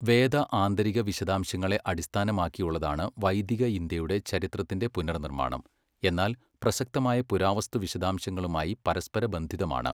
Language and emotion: Malayalam, neutral